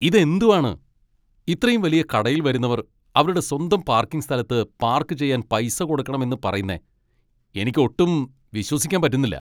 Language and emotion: Malayalam, angry